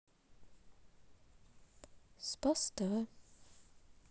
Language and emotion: Russian, sad